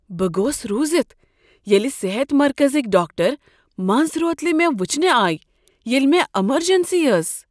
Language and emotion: Kashmiri, surprised